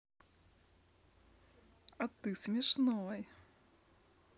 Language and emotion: Russian, positive